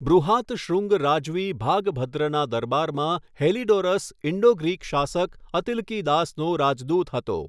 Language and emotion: Gujarati, neutral